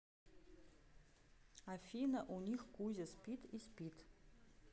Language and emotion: Russian, neutral